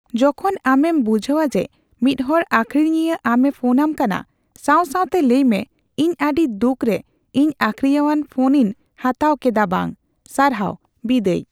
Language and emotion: Santali, neutral